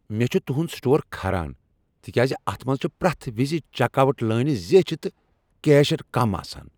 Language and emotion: Kashmiri, angry